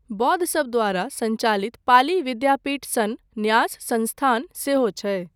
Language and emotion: Maithili, neutral